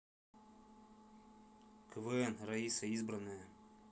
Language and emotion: Russian, neutral